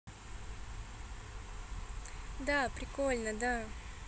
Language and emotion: Russian, positive